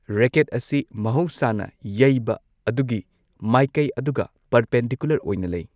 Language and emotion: Manipuri, neutral